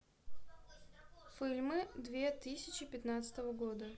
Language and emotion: Russian, neutral